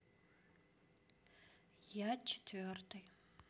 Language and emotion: Russian, neutral